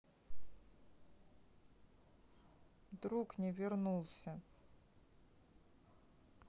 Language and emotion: Russian, sad